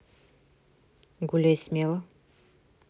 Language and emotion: Russian, neutral